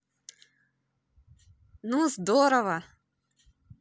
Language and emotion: Russian, positive